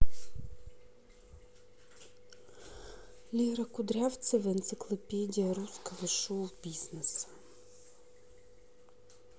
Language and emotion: Russian, neutral